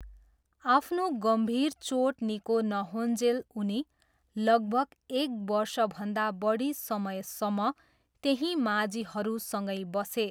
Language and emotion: Nepali, neutral